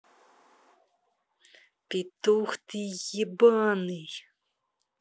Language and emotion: Russian, angry